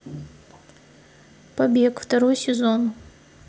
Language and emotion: Russian, neutral